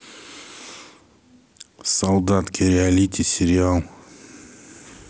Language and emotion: Russian, neutral